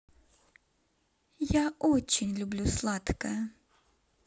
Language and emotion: Russian, neutral